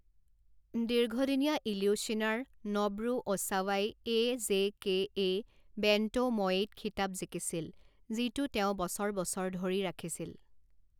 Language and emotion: Assamese, neutral